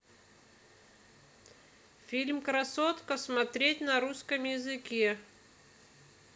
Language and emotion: Russian, neutral